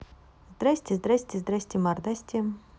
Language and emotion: Russian, positive